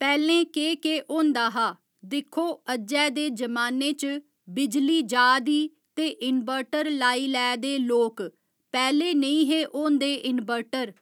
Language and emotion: Dogri, neutral